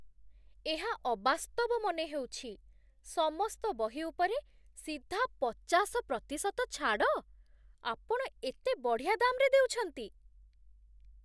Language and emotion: Odia, surprised